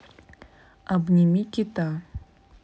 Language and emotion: Russian, neutral